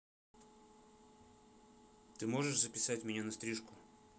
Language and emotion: Russian, angry